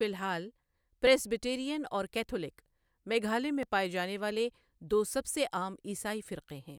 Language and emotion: Urdu, neutral